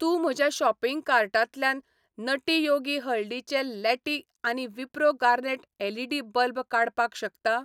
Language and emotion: Goan Konkani, neutral